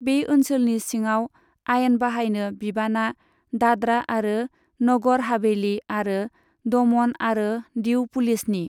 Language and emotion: Bodo, neutral